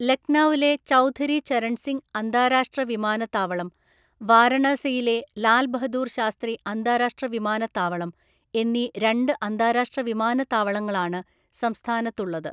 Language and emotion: Malayalam, neutral